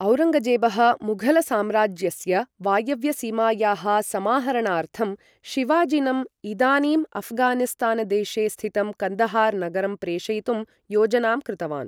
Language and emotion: Sanskrit, neutral